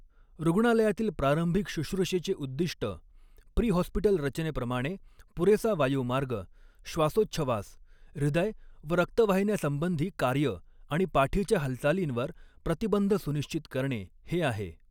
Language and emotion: Marathi, neutral